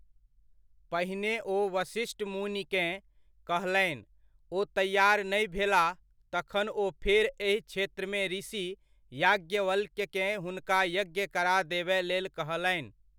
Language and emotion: Maithili, neutral